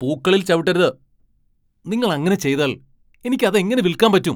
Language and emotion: Malayalam, angry